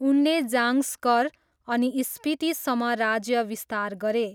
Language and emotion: Nepali, neutral